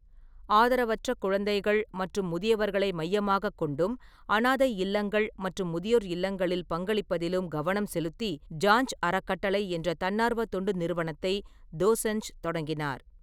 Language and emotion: Tamil, neutral